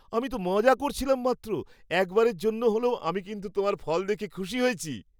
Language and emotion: Bengali, happy